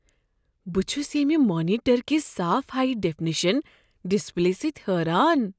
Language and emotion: Kashmiri, surprised